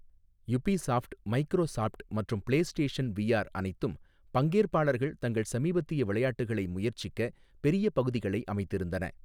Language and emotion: Tamil, neutral